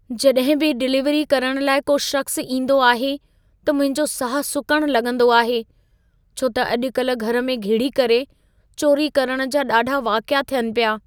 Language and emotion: Sindhi, fearful